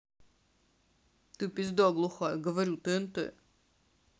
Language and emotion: Russian, sad